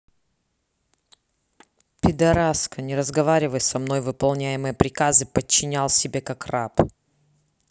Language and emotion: Russian, angry